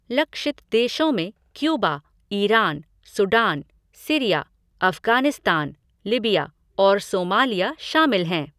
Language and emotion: Hindi, neutral